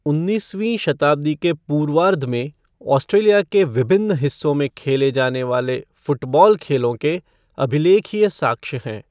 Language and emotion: Hindi, neutral